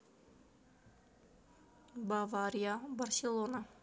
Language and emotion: Russian, neutral